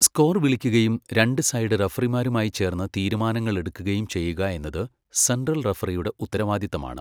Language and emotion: Malayalam, neutral